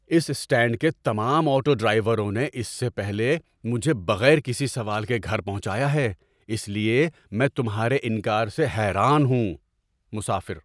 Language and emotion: Urdu, surprised